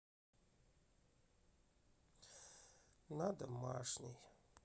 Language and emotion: Russian, sad